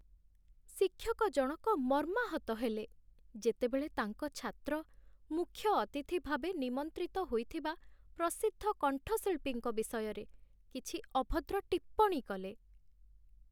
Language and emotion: Odia, sad